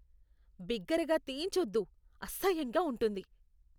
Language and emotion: Telugu, disgusted